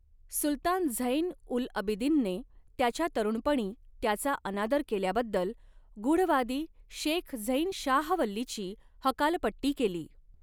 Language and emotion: Marathi, neutral